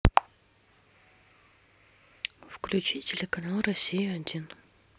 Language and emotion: Russian, neutral